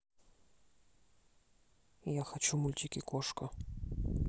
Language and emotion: Russian, neutral